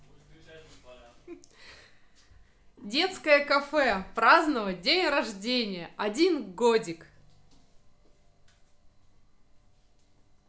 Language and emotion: Russian, positive